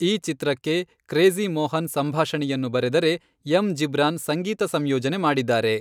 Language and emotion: Kannada, neutral